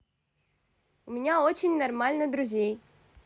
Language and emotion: Russian, positive